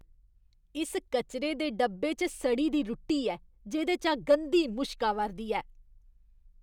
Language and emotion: Dogri, disgusted